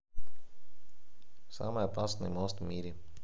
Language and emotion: Russian, neutral